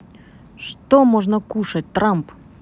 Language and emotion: Russian, neutral